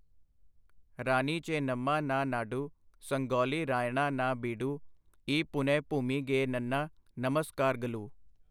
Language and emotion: Punjabi, neutral